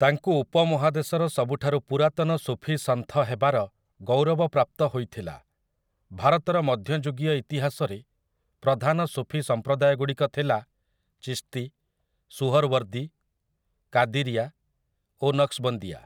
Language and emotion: Odia, neutral